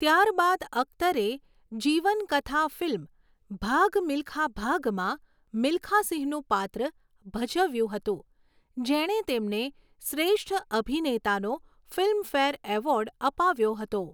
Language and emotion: Gujarati, neutral